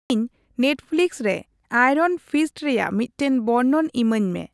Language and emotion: Santali, neutral